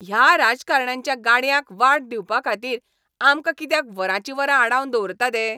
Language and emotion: Goan Konkani, angry